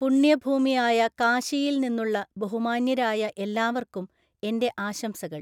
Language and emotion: Malayalam, neutral